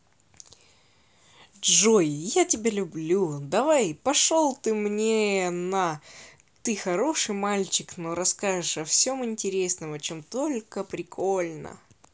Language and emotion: Russian, positive